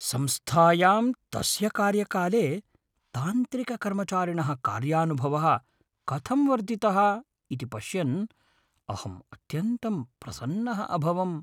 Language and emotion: Sanskrit, happy